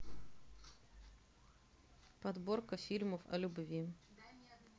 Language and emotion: Russian, neutral